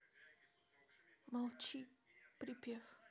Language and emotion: Russian, sad